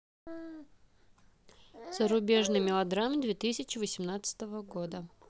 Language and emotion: Russian, neutral